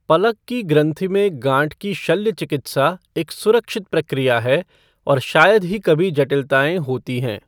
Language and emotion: Hindi, neutral